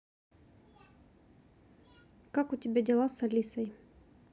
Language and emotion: Russian, neutral